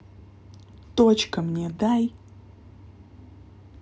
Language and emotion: Russian, angry